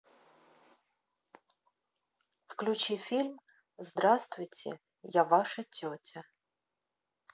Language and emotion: Russian, neutral